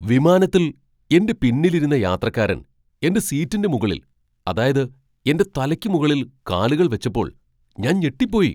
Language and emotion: Malayalam, surprised